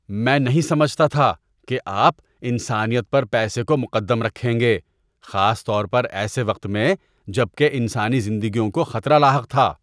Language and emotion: Urdu, disgusted